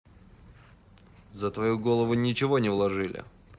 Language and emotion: Russian, angry